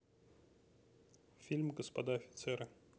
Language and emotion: Russian, neutral